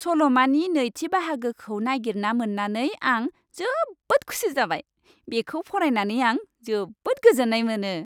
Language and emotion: Bodo, happy